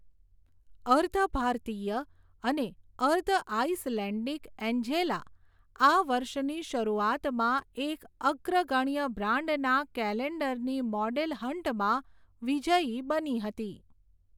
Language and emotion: Gujarati, neutral